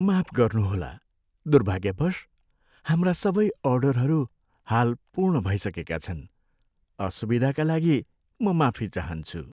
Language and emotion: Nepali, sad